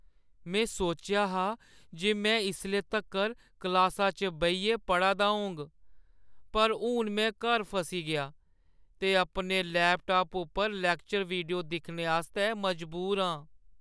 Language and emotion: Dogri, sad